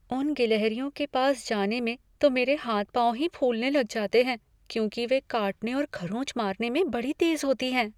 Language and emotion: Hindi, fearful